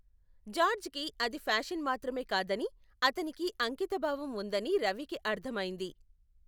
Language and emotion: Telugu, neutral